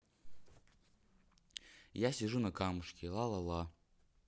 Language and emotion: Russian, neutral